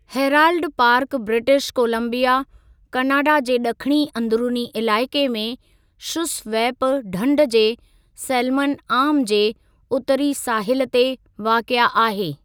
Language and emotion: Sindhi, neutral